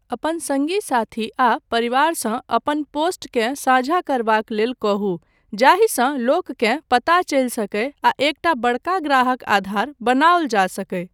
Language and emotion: Maithili, neutral